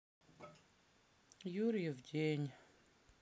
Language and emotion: Russian, sad